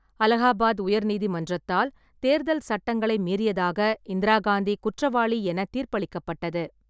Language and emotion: Tamil, neutral